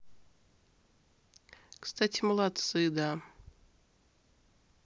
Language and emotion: Russian, neutral